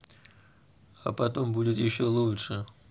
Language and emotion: Russian, neutral